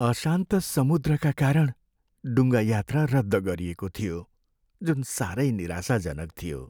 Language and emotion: Nepali, sad